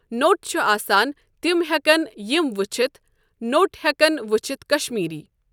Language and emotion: Kashmiri, neutral